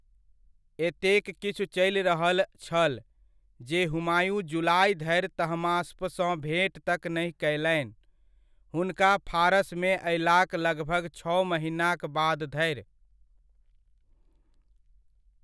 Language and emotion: Maithili, neutral